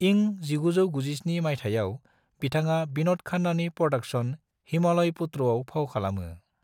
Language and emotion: Bodo, neutral